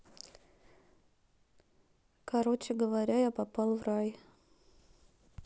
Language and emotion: Russian, neutral